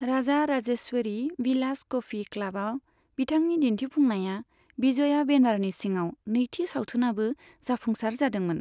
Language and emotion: Bodo, neutral